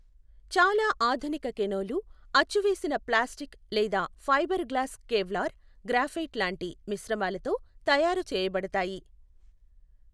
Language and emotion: Telugu, neutral